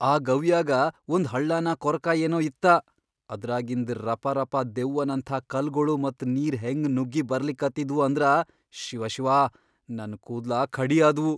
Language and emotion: Kannada, fearful